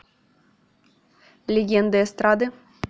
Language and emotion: Russian, neutral